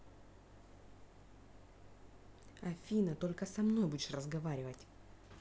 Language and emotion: Russian, angry